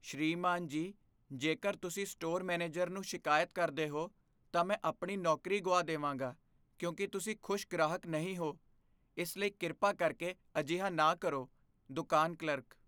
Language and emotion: Punjabi, fearful